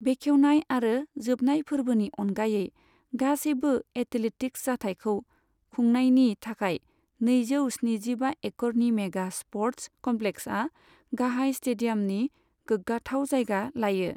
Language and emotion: Bodo, neutral